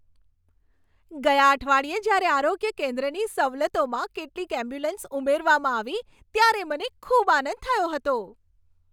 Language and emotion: Gujarati, happy